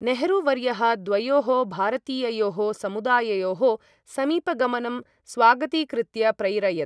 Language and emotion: Sanskrit, neutral